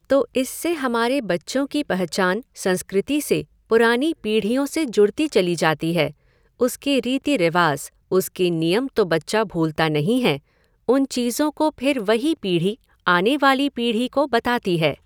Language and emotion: Hindi, neutral